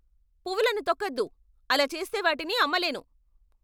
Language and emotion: Telugu, angry